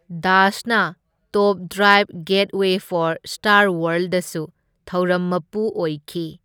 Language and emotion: Manipuri, neutral